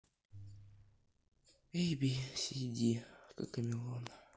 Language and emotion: Russian, sad